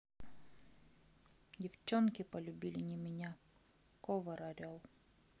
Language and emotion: Russian, sad